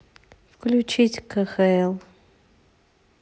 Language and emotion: Russian, neutral